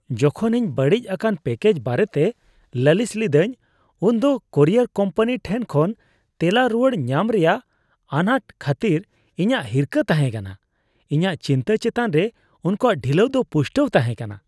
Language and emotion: Santali, disgusted